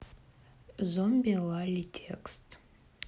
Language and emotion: Russian, neutral